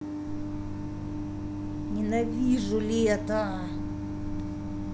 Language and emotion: Russian, angry